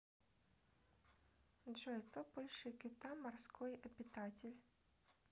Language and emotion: Russian, neutral